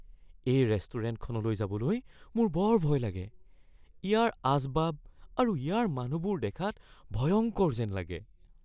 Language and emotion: Assamese, fearful